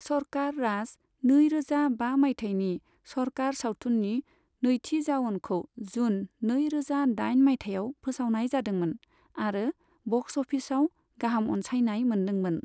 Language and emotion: Bodo, neutral